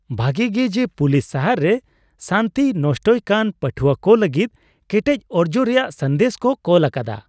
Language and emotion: Santali, happy